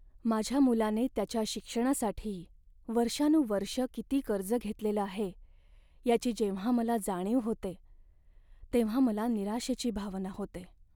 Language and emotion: Marathi, sad